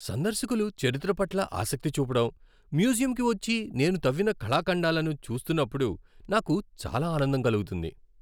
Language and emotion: Telugu, happy